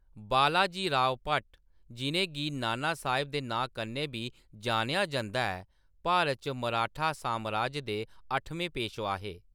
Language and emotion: Dogri, neutral